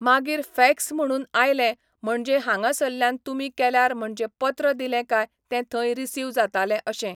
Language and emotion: Goan Konkani, neutral